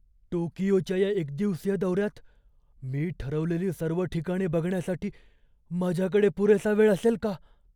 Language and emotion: Marathi, fearful